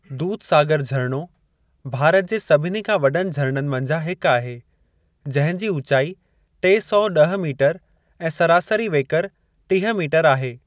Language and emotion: Sindhi, neutral